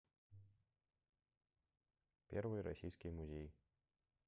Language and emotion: Russian, neutral